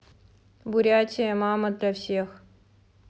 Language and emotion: Russian, neutral